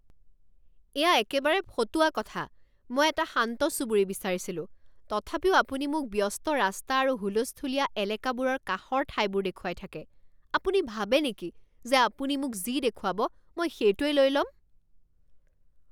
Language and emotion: Assamese, angry